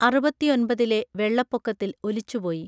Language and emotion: Malayalam, neutral